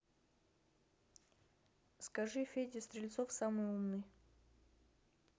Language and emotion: Russian, neutral